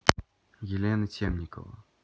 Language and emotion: Russian, neutral